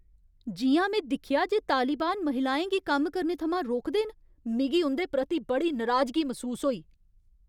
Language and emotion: Dogri, angry